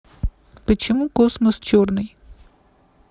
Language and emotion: Russian, neutral